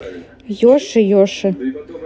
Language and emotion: Russian, neutral